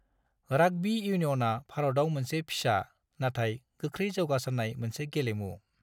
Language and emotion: Bodo, neutral